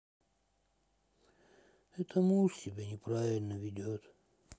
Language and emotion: Russian, sad